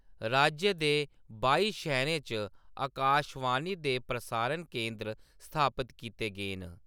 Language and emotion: Dogri, neutral